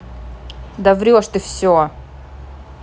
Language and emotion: Russian, angry